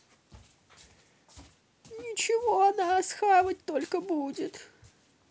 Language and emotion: Russian, sad